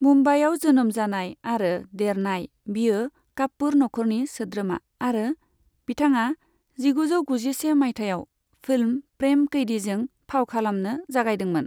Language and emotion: Bodo, neutral